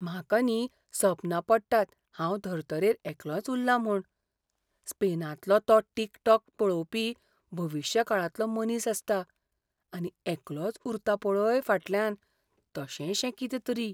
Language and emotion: Goan Konkani, fearful